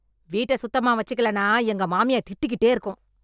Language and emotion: Tamil, angry